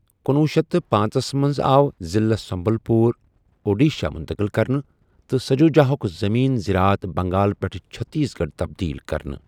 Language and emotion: Kashmiri, neutral